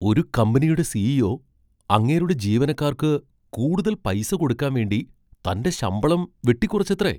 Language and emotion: Malayalam, surprised